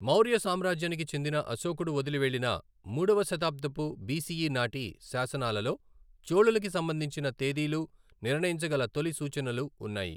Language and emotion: Telugu, neutral